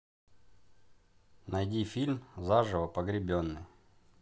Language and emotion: Russian, neutral